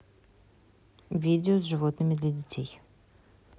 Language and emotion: Russian, neutral